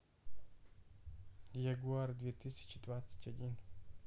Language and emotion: Russian, neutral